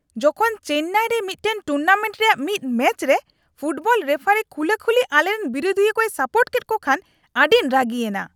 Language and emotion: Santali, angry